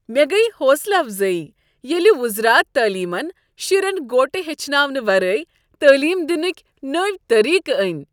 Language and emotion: Kashmiri, happy